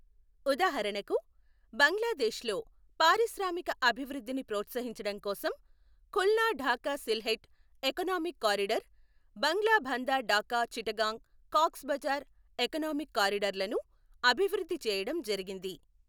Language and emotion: Telugu, neutral